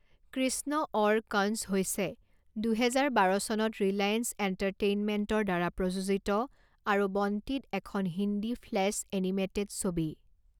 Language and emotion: Assamese, neutral